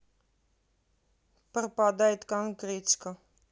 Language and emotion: Russian, neutral